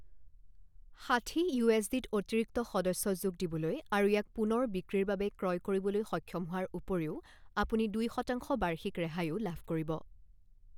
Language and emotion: Assamese, neutral